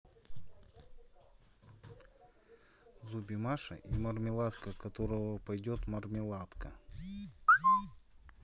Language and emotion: Russian, neutral